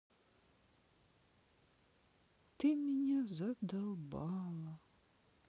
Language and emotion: Russian, sad